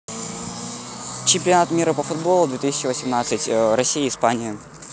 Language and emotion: Russian, neutral